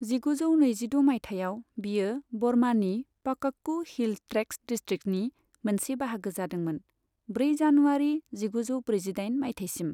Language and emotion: Bodo, neutral